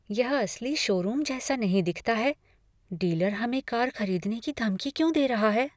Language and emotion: Hindi, fearful